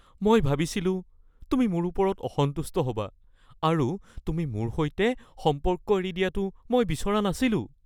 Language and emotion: Assamese, fearful